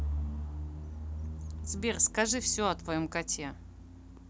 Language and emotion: Russian, neutral